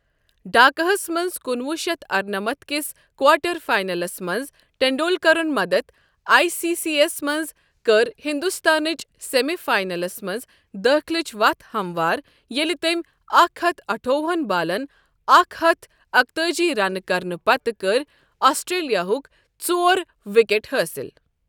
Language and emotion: Kashmiri, neutral